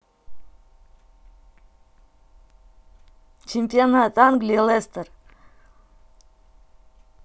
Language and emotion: Russian, neutral